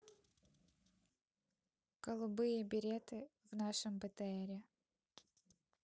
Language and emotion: Russian, neutral